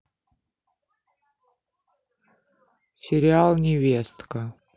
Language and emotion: Russian, neutral